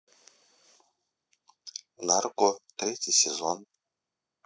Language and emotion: Russian, neutral